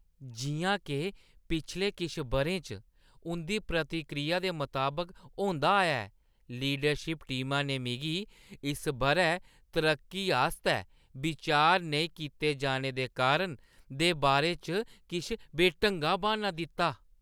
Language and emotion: Dogri, disgusted